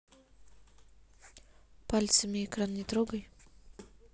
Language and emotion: Russian, neutral